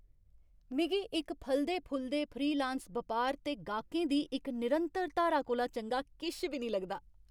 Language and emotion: Dogri, happy